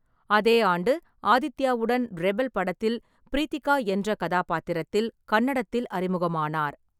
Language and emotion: Tamil, neutral